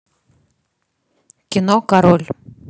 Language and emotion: Russian, neutral